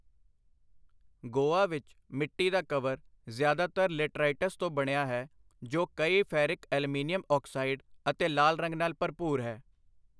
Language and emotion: Punjabi, neutral